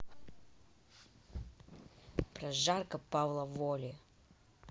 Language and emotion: Russian, angry